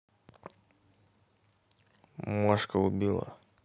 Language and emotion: Russian, neutral